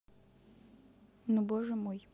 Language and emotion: Russian, neutral